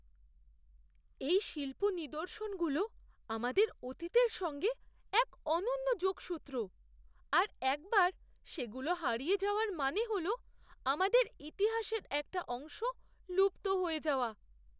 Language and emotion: Bengali, fearful